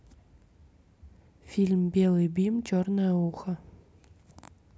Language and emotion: Russian, neutral